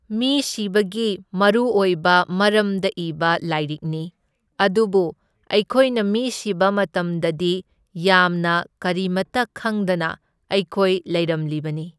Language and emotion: Manipuri, neutral